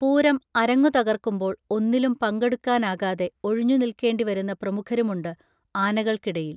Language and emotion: Malayalam, neutral